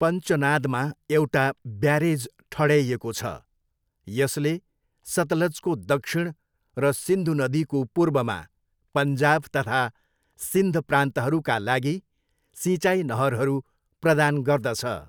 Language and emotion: Nepali, neutral